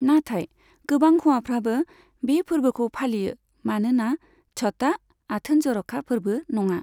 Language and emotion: Bodo, neutral